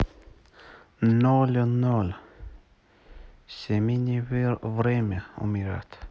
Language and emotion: Russian, neutral